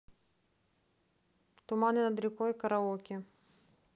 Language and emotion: Russian, neutral